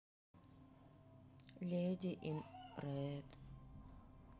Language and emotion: Russian, sad